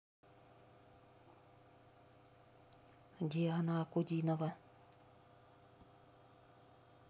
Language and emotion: Russian, neutral